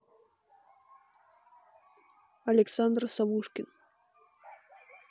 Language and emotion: Russian, neutral